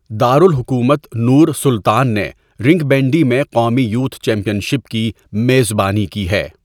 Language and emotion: Urdu, neutral